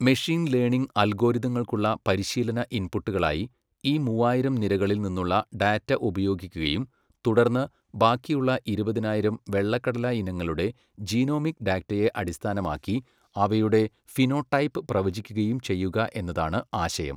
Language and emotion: Malayalam, neutral